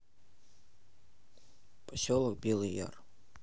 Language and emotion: Russian, neutral